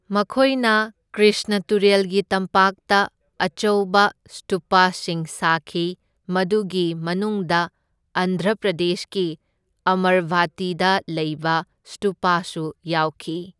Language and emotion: Manipuri, neutral